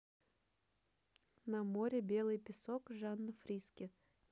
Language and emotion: Russian, neutral